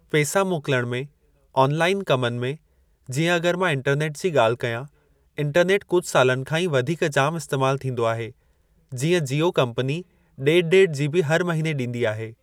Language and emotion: Sindhi, neutral